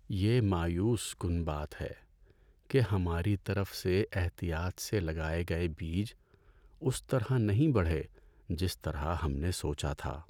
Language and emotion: Urdu, sad